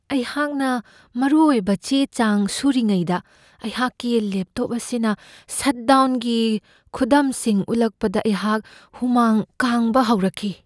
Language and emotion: Manipuri, fearful